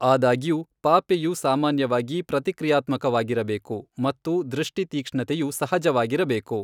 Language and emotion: Kannada, neutral